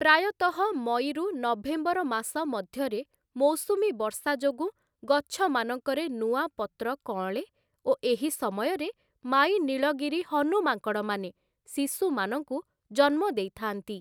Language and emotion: Odia, neutral